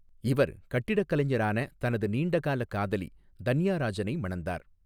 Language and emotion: Tamil, neutral